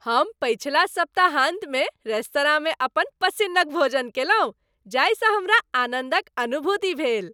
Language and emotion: Maithili, happy